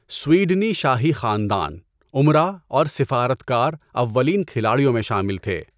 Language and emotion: Urdu, neutral